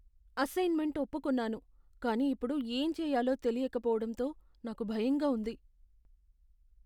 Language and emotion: Telugu, fearful